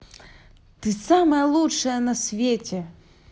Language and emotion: Russian, positive